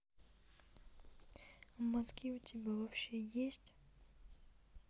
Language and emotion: Russian, neutral